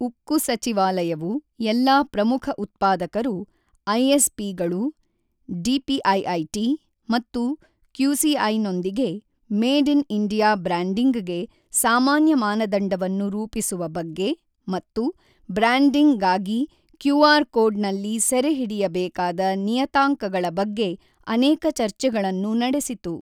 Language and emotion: Kannada, neutral